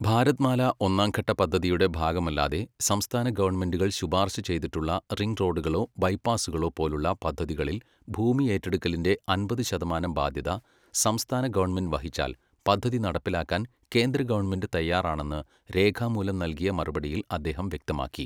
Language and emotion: Malayalam, neutral